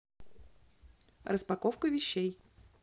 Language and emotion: Russian, neutral